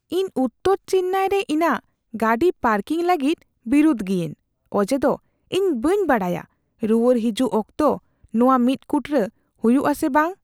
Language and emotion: Santali, fearful